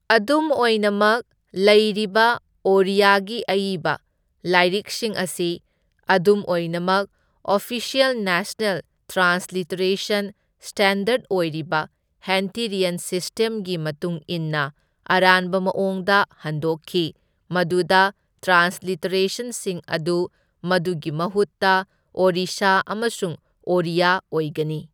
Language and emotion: Manipuri, neutral